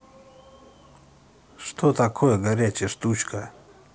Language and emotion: Russian, neutral